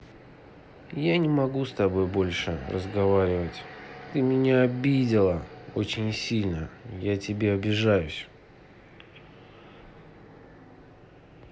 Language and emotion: Russian, sad